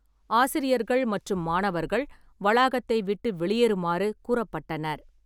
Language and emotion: Tamil, neutral